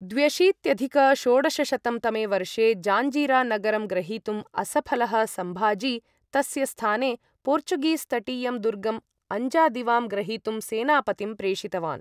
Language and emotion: Sanskrit, neutral